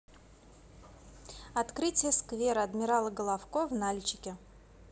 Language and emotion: Russian, positive